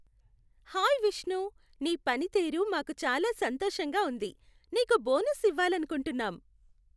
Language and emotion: Telugu, happy